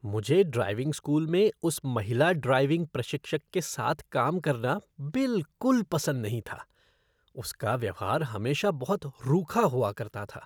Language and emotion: Hindi, disgusted